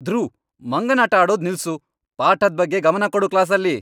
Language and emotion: Kannada, angry